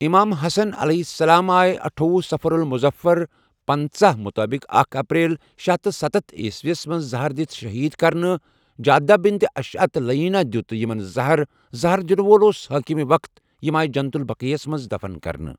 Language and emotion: Kashmiri, neutral